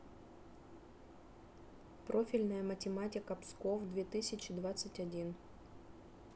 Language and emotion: Russian, neutral